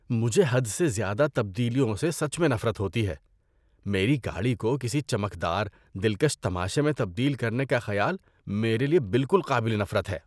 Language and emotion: Urdu, disgusted